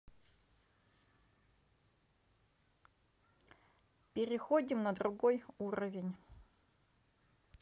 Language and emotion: Russian, neutral